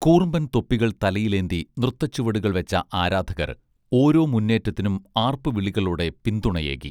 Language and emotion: Malayalam, neutral